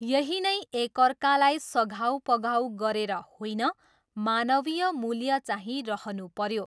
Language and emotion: Nepali, neutral